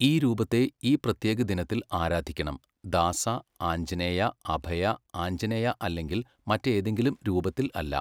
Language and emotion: Malayalam, neutral